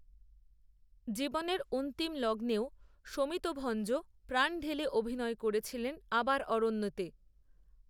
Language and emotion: Bengali, neutral